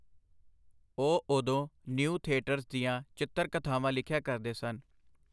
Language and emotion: Punjabi, neutral